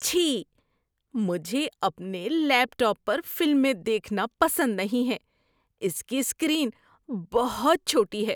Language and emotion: Urdu, disgusted